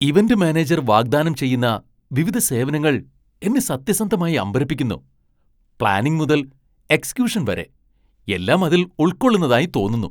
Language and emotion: Malayalam, surprised